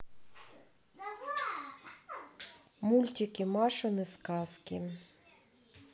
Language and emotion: Russian, neutral